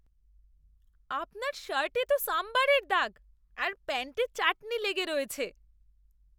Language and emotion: Bengali, disgusted